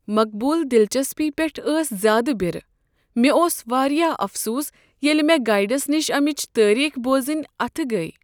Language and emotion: Kashmiri, sad